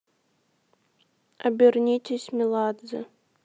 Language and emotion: Russian, neutral